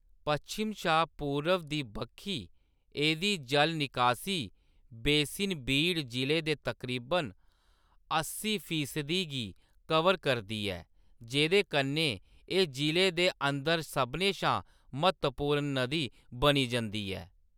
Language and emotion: Dogri, neutral